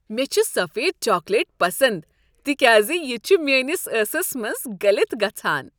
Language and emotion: Kashmiri, happy